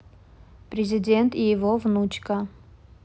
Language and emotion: Russian, neutral